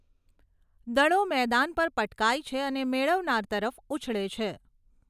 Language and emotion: Gujarati, neutral